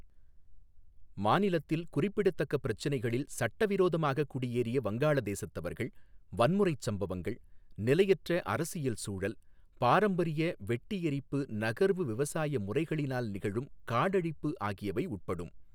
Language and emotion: Tamil, neutral